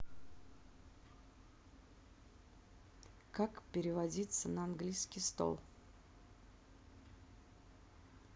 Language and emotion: Russian, neutral